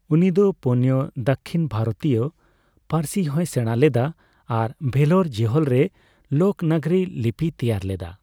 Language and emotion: Santali, neutral